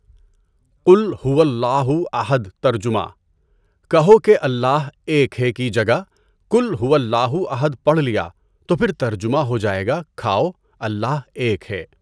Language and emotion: Urdu, neutral